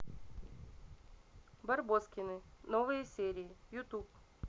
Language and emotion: Russian, neutral